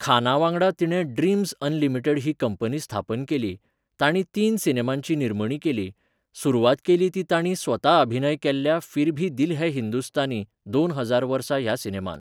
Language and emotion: Goan Konkani, neutral